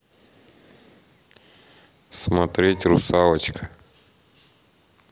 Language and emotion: Russian, neutral